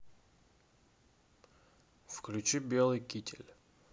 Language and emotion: Russian, neutral